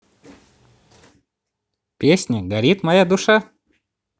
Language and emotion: Russian, positive